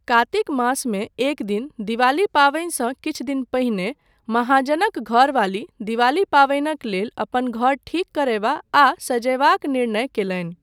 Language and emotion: Maithili, neutral